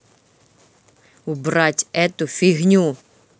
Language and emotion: Russian, angry